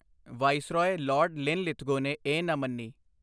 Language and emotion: Punjabi, neutral